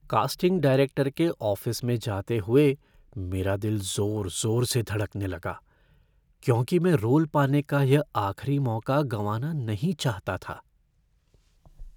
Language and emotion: Hindi, fearful